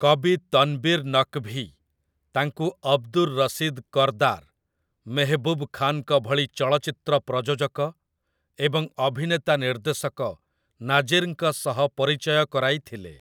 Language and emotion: Odia, neutral